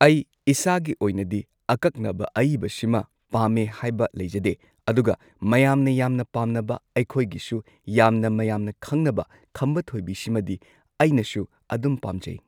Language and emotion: Manipuri, neutral